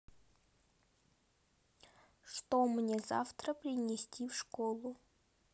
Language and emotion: Russian, neutral